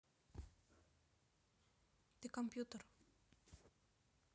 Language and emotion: Russian, neutral